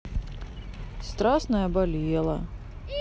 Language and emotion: Russian, sad